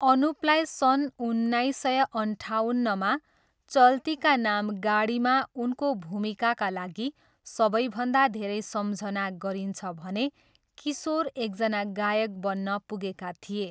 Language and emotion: Nepali, neutral